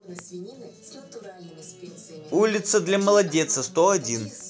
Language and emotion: Russian, positive